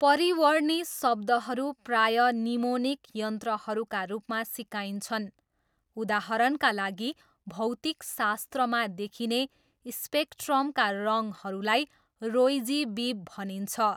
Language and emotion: Nepali, neutral